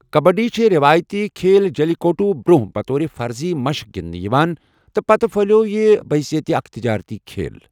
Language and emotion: Kashmiri, neutral